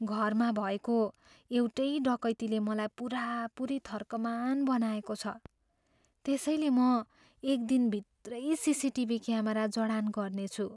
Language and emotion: Nepali, fearful